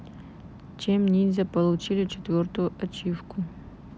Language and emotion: Russian, neutral